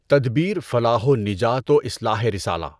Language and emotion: Urdu, neutral